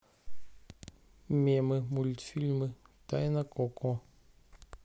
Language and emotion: Russian, neutral